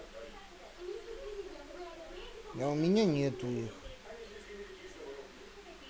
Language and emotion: Russian, sad